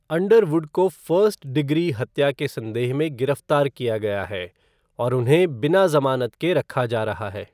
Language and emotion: Hindi, neutral